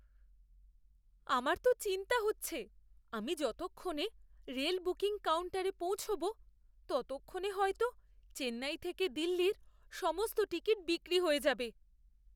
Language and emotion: Bengali, fearful